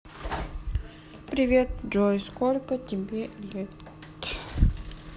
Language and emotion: Russian, sad